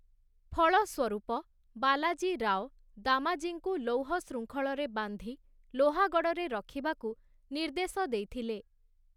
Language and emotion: Odia, neutral